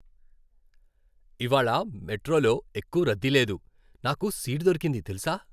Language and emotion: Telugu, happy